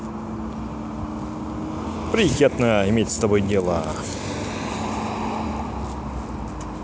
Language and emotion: Russian, positive